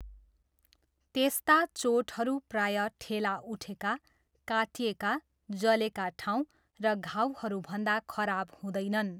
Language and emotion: Nepali, neutral